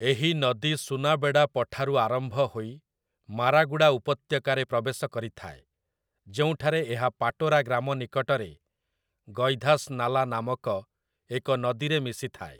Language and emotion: Odia, neutral